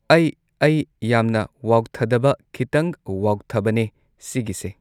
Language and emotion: Manipuri, neutral